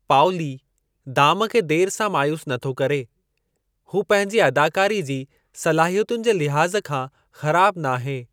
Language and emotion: Sindhi, neutral